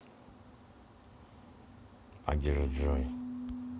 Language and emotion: Russian, neutral